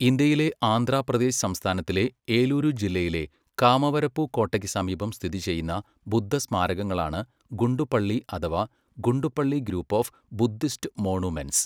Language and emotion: Malayalam, neutral